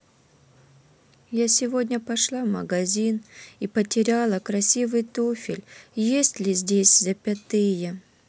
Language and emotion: Russian, sad